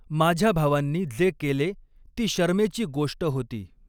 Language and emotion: Marathi, neutral